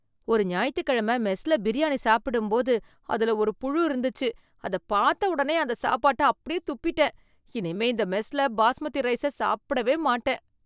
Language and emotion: Tamil, disgusted